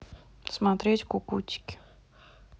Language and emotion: Russian, neutral